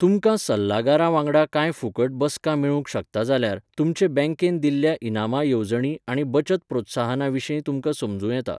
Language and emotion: Goan Konkani, neutral